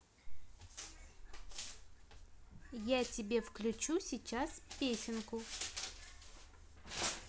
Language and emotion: Russian, positive